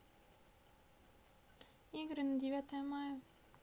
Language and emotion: Russian, neutral